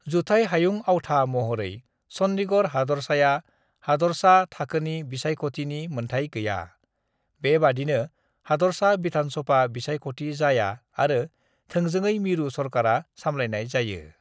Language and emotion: Bodo, neutral